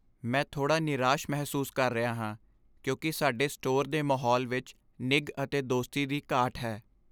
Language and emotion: Punjabi, sad